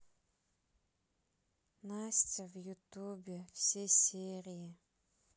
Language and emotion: Russian, sad